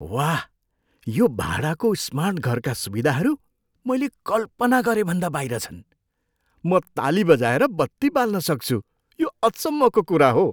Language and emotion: Nepali, surprised